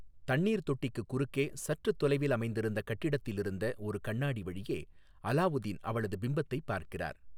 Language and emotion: Tamil, neutral